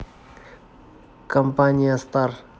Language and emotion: Russian, neutral